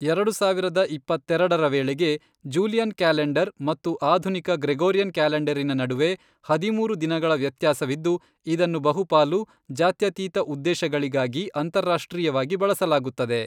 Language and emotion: Kannada, neutral